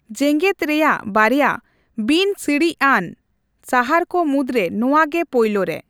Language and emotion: Santali, neutral